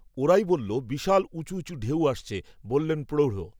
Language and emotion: Bengali, neutral